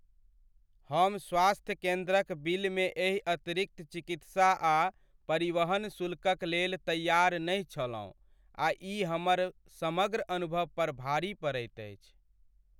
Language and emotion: Maithili, sad